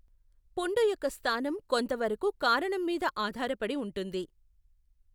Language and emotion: Telugu, neutral